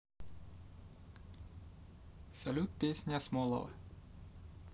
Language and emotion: Russian, positive